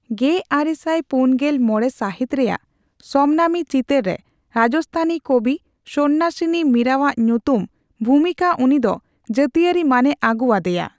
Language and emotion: Santali, neutral